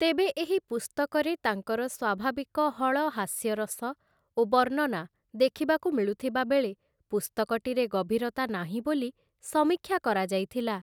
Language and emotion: Odia, neutral